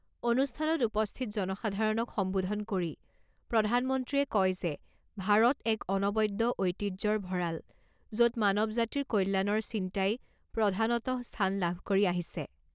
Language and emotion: Assamese, neutral